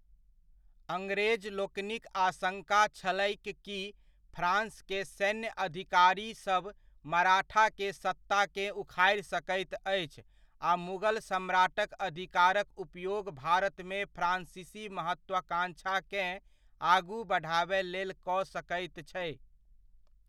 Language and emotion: Maithili, neutral